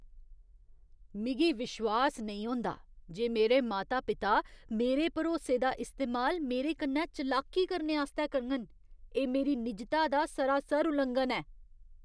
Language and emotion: Dogri, disgusted